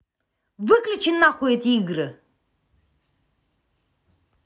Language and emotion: Russian, angry